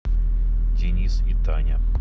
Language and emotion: Russian, neutral